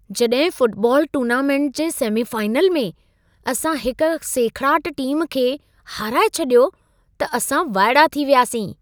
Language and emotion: Sindhi, surprised